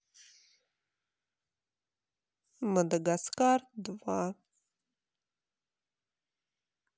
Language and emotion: Russian, sad